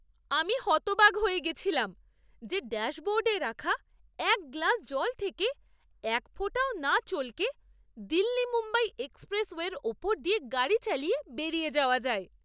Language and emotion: Bengali, surprised